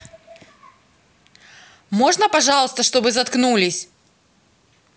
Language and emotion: Russian, angry